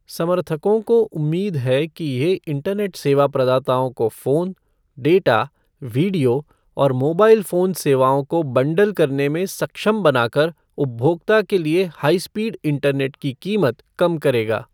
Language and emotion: Hindi, neutral